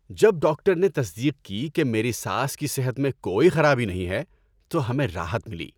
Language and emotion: Urdu, happy